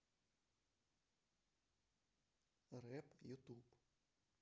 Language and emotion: Russian, neutral